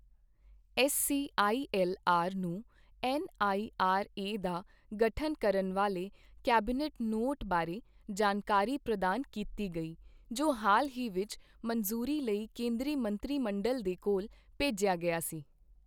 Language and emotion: Punjabi, neutral